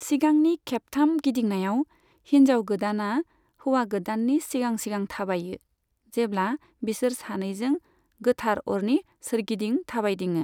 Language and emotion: Bodo, neutral